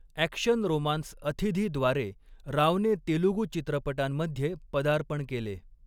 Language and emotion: Marathi, neutral